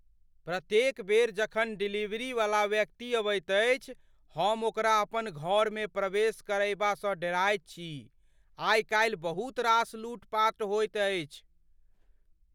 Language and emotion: Maithili, fearful